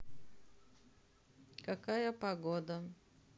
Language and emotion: Russian, neutral